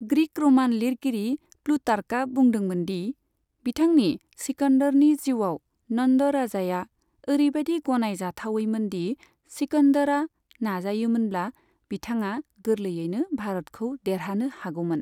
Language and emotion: Bodo, neutral